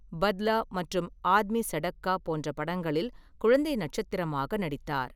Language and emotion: Tamil, neutral